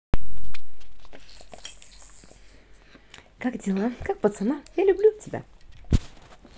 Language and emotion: Russian, positive